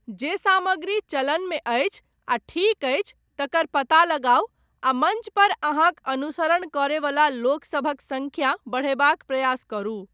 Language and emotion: Maithili, neutral